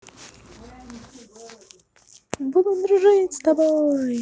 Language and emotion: Russian, positive